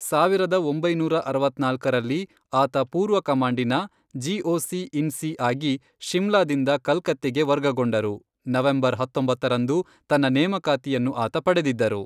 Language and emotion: Kannada, neutral